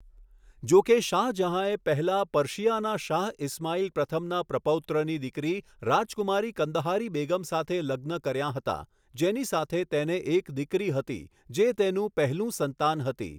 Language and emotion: Gujarati, neutral